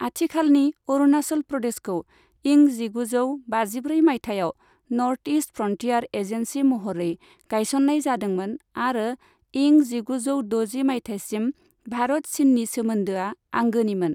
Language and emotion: Bodo, neutral